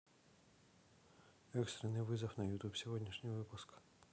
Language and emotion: Russian, neutral